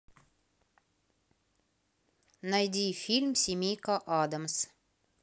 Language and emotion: Russian, neutral